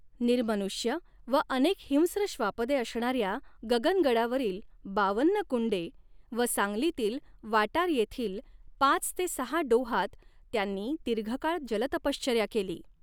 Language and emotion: Marathi, neutral